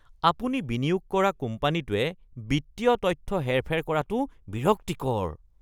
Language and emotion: Assamese, disgusted